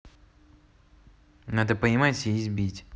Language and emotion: Russian, neutral